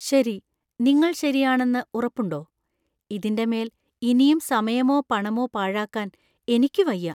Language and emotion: Malayalam, fearful